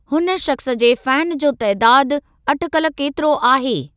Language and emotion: Sindhi, neutral